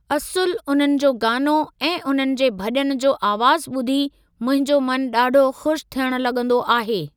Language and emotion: Sindhi, neutral